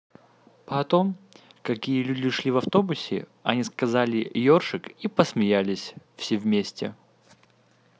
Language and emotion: Russian, neutral